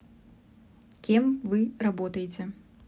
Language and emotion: Russian, neutral